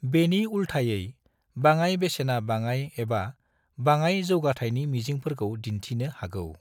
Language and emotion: Bodo, neutral